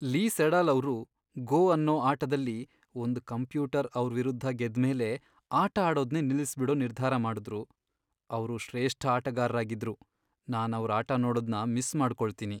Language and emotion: Kannada, sad